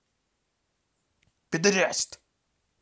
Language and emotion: Russian, angry